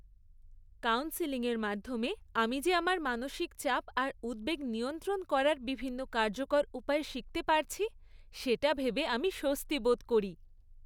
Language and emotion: Bengali, happy